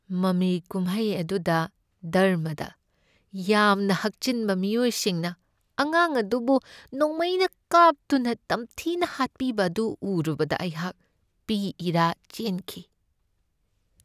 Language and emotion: Manipuri, sad